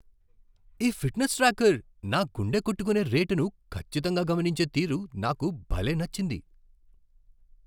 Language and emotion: Telugu, surprised